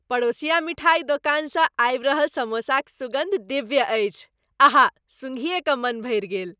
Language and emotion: Maithili, happy